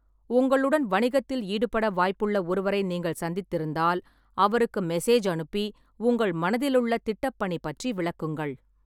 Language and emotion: Tamil, neutral